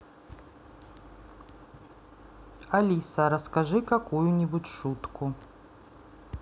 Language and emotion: Russian, neutral